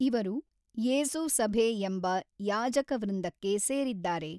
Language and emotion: Kannada, neutral